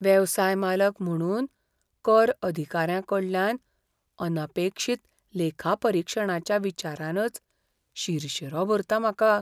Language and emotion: Goan Konkani, fearful